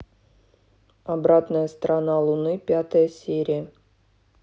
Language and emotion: Russian, neutral